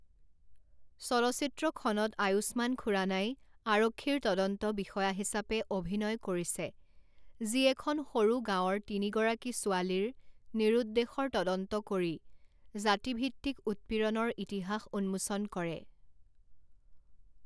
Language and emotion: Assamese, neutral